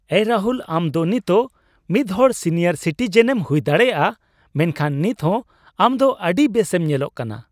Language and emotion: Santali, happy